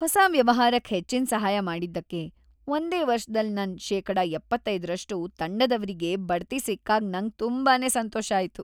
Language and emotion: Kannada, happy